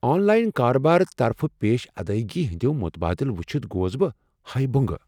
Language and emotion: Kashmiri, surprised